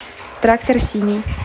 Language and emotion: Russian, neutral